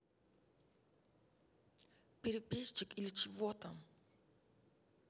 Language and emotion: Russian, angry